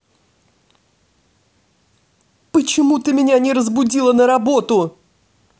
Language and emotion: Russian, angry